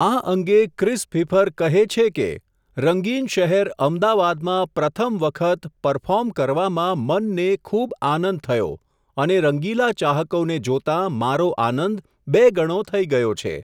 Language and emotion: Gujarati, neutral